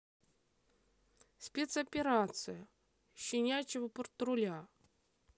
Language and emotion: Russian, neutral